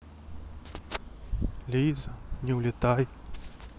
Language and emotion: Russian, sad